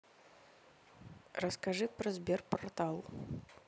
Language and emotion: Russian, neutral